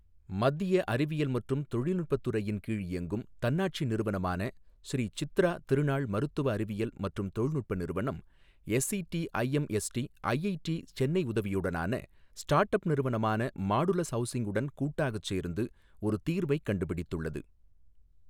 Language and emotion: Tamil, neutral